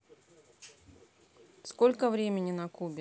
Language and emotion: Russian, neutral